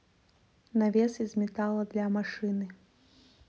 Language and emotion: Russian, neutral